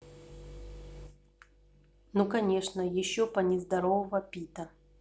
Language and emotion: Russian, neutral